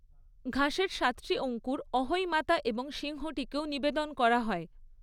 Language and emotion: Bengali, neutral